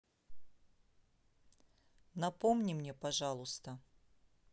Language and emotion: Russian, neutral